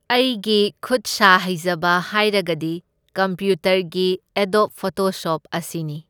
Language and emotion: Manipuri, neutral